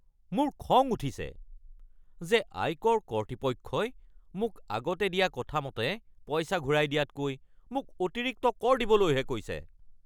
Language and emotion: Assamese, angry